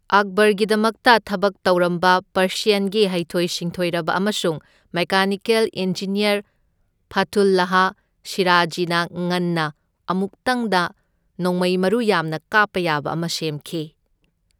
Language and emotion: Manipuri, neutral